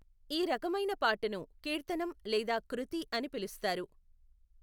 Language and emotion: Telugu, neutral